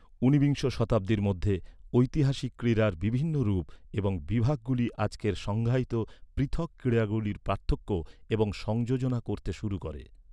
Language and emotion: Bengali, neutral